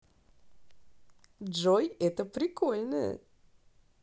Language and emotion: Russian, positive